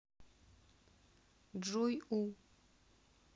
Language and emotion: Russian, neutral